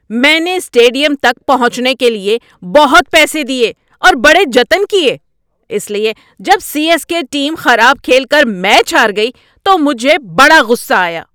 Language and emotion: Urdu, angry